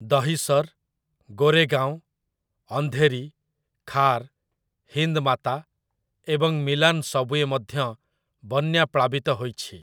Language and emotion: Odia, neutral